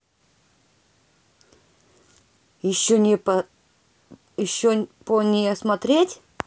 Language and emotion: Russian, neutral